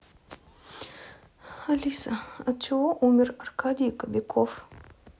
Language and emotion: Russian, sad